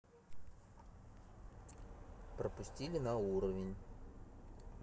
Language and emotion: Russian, neutral